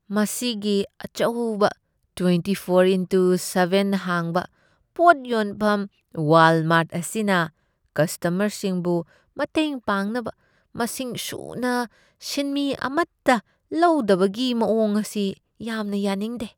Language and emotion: Manipuri, disgusted